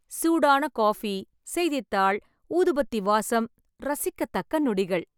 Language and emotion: Tamil, happy